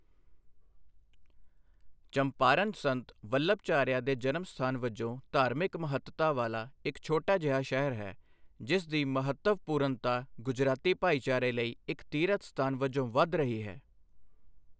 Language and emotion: Punjabi, neutral